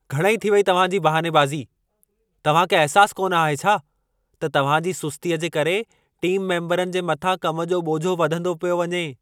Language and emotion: Sindhi, angry